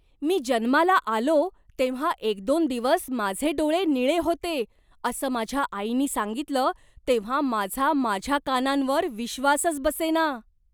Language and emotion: Marathi, surprised